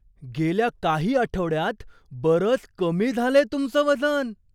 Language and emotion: Marathi, surprised